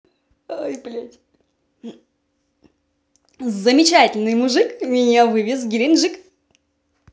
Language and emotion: Russian, positive